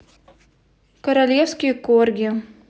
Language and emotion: Russian, neutral